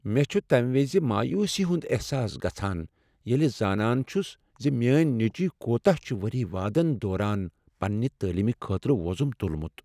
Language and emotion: Kashmiri, sad